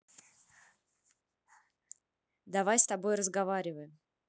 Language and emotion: Russian, neutral